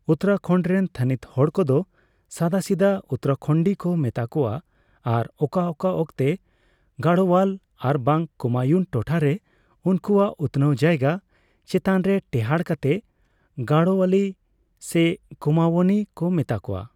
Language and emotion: Santali, neutral